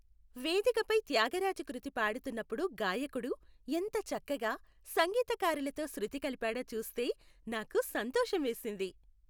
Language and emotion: Telugu, happy